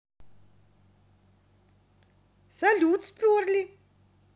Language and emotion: Russian, positive